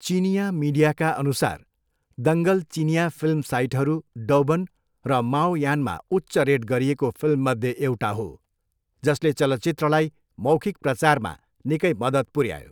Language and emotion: Nepali, neutral